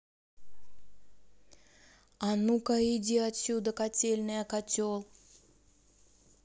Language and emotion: Russian, angry